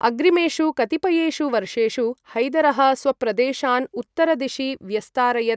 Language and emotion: Sanskrit, neutral